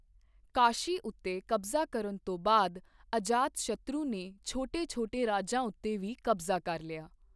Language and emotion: Punjabi, neutral